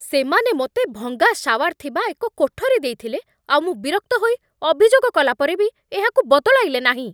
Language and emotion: Odia, angry